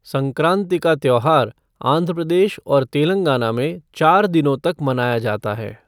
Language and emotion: Hindi, neutral